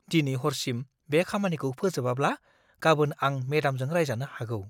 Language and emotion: Bodo, fearful